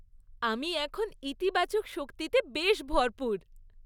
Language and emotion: Bengali, happy